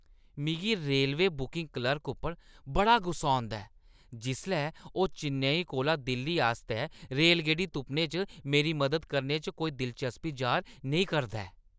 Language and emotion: Dogri, disgusted